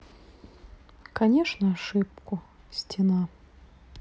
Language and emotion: Russian, sad